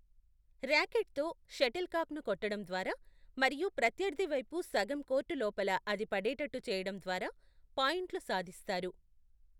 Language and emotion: Telugu, neutral